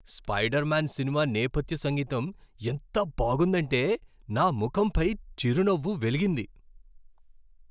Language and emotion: Telugu, happy